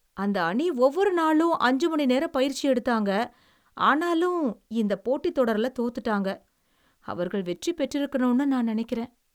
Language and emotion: Tamil, sad